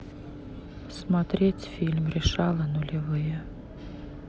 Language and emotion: Russian, neutral